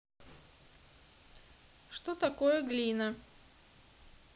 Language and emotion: Russian, neutral